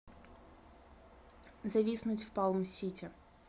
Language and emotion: Russian, neutral